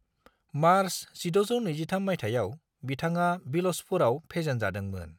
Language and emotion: Bodo, neutral